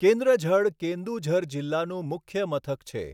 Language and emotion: Gujarati, neutral